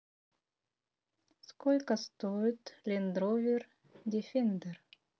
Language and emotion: Russian, neutral